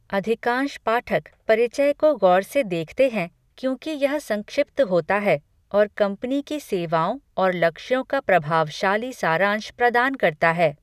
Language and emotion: Hindi, neutral